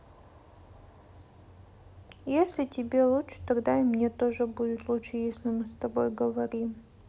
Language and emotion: Russian, sad